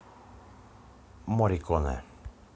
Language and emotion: Russian, neutral